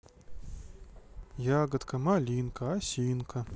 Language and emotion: Russian, neutral